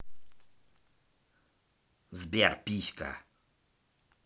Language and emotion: Russian, angry